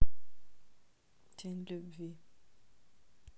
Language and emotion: Russian, neutral